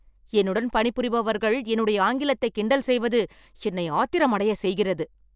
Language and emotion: Tamil, angry